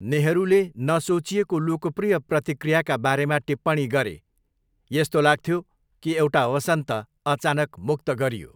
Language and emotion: Nepali, neutral